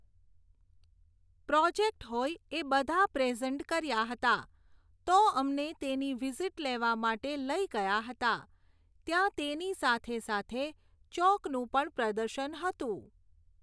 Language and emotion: Gujarati, neutral